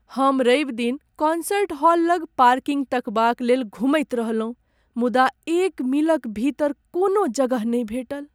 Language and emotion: Maithili, sad